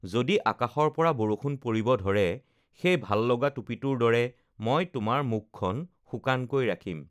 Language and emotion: Assamese, neutral